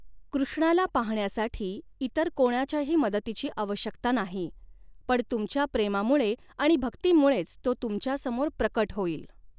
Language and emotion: Marathi, neutral